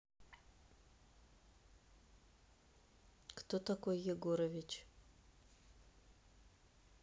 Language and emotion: Russian, neutral